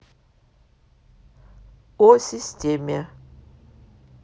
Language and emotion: Russian, neutral